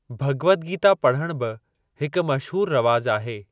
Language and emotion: Sindhi, neutral